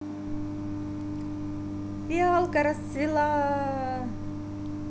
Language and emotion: Russian, positive